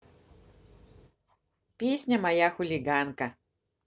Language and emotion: Russian, positive